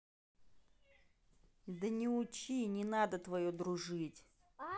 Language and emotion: Russian, angry